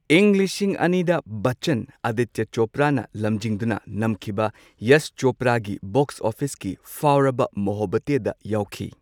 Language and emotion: Manipuri, neutral